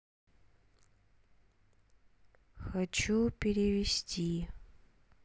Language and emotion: Russian, sad